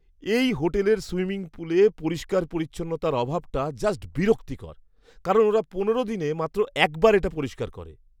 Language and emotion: Bengali, disgusted